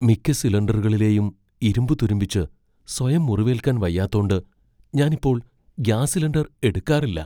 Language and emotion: Malayalam, fearful